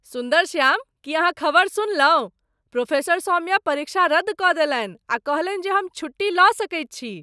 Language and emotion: Maithili, surprised